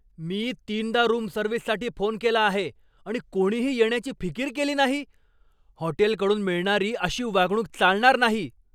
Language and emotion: Marathi, angry